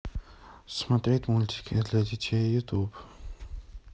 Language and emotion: Russian, neutral